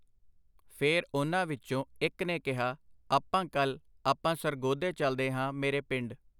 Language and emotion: Punjabi, neutral